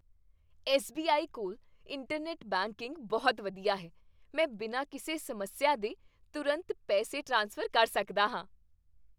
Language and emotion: Punjabi, happy